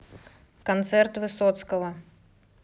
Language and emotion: Russian, neutral